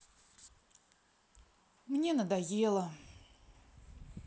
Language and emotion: Russian, sad